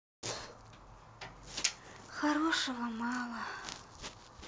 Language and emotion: Russian, sad